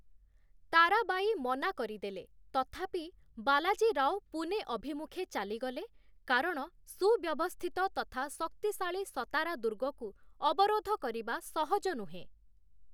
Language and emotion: Odia, neutral